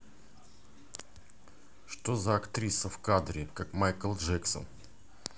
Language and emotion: Russian, angry